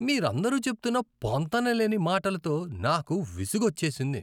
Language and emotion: Telugu, disgusted